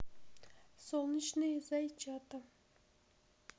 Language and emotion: Russian, neutral